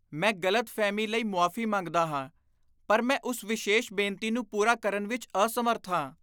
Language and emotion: Punjabi, disgusted